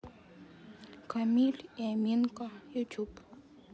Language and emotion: Russian, sad